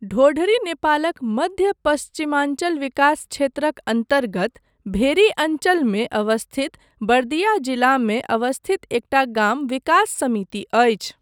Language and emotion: Maithili, neutral